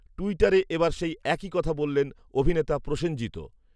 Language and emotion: Bengali, neutral